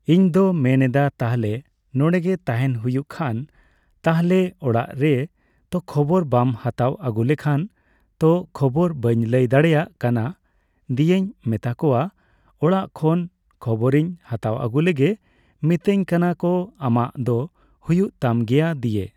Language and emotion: Santali, neutral